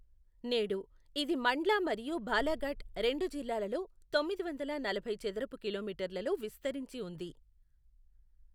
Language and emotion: Telugu, neutral